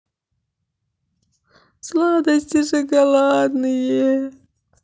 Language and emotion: Russian, sad